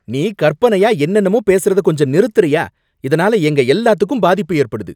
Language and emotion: Tamil, angry